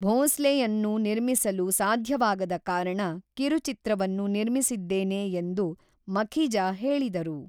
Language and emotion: Kannada, neutral